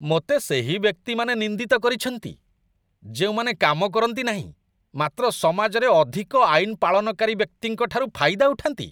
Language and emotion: Odia, disgusted